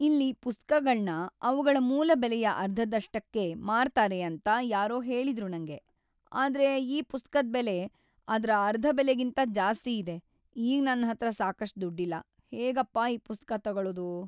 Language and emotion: Kannada, sad